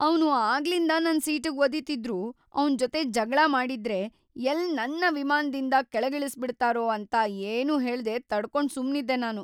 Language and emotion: Kannada, fearful